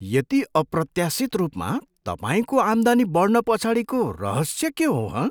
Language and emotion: Nepali, surprised